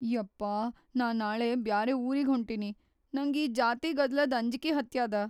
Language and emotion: Kannada, fearful